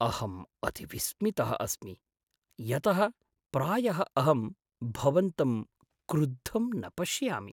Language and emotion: Sanskrit, surprised